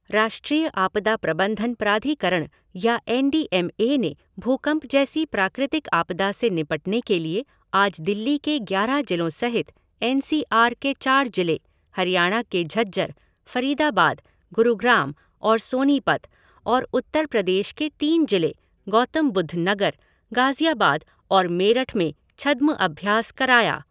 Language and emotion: Hindi, neutral